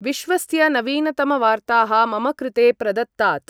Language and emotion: Sanskrit, neutral